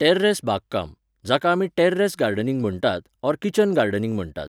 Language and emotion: Goan Konkani, neutral